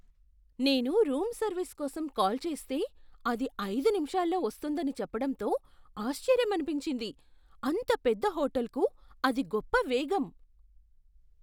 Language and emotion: Telugu, surprised